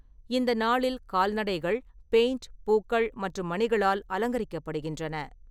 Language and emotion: Tamil, neutral